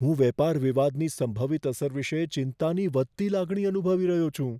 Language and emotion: Gujarati, fearful